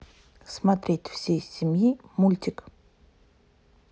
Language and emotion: Russian, neutral